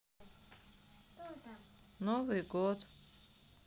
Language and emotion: Russian, sad